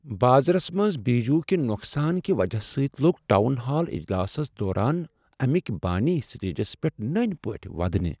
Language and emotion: Kashmiri, sad